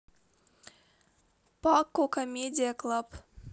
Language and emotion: Russian, neutral